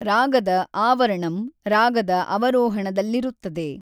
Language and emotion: Kannada, neutral